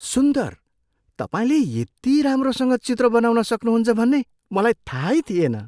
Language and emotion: Nepali, surprised